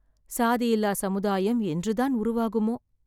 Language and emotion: Tamil, sad